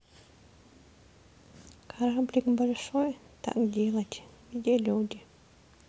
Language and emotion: Russian, sad